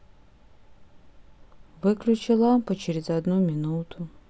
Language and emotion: Russian, sad